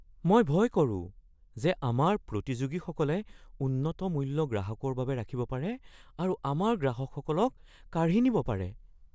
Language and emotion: Assamese, fearful